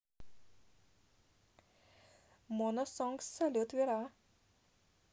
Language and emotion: Russian, positive